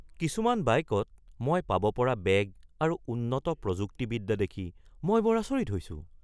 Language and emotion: Assamese, surprised